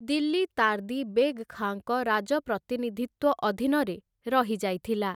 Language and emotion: Odia, neutral